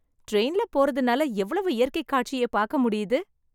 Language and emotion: Tamil, happy